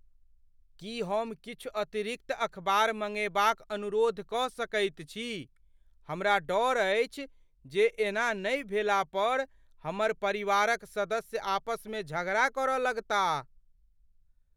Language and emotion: Maithili, fearful